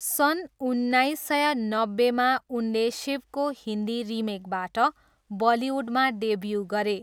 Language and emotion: Nepali, neutral